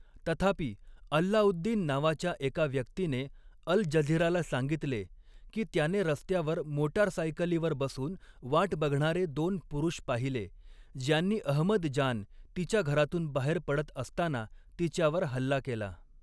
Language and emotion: Marathi, neutral